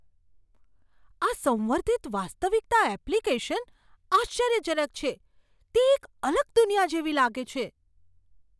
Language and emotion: Gujarati, surprised